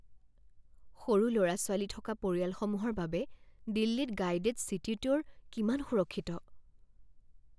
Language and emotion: Assamese, fearful